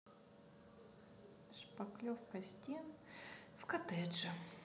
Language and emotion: Russian, sad